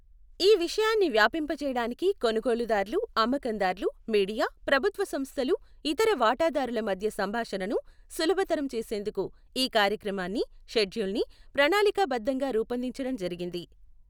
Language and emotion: Telugu, neutral